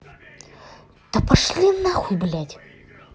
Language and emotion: Russian, angry